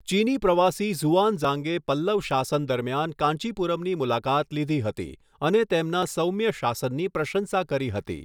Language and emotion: Gujarati, neutral